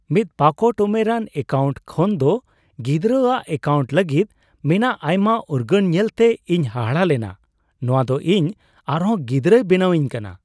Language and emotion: Santali, surprised